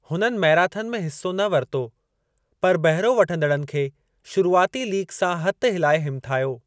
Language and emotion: Sindhi, neutral